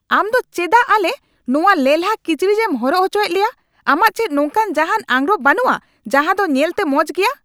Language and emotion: Santali, angry